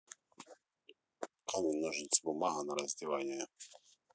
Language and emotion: Russian, neutral